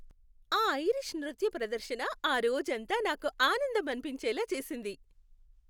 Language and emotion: Telugu, happy